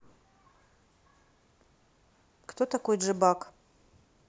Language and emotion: Russian, neutral